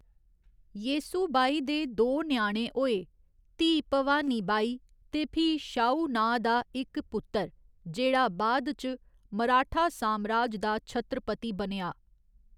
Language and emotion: Dogri, neutral